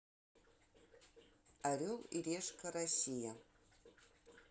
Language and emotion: Russian, neutral